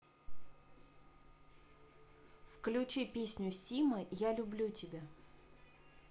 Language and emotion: Russian, neutral